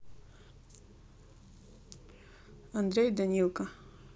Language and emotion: Russian, neutral